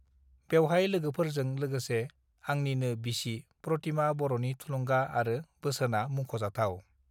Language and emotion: Bodo, neutral